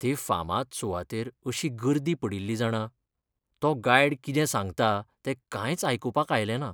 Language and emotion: Goan Konkani, sad